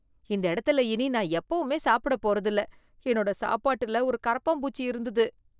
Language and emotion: Tamil, disgusted